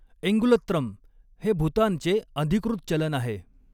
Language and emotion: Marathi, neutral